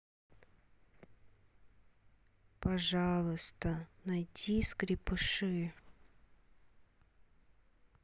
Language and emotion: Russian, sad